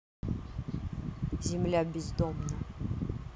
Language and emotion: Russian, neutral